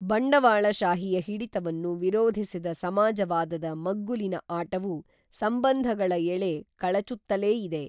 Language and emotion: Kannada, neutral